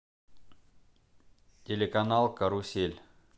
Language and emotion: Russian, neutral